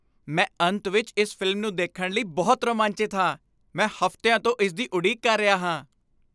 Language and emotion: Punjabi, happy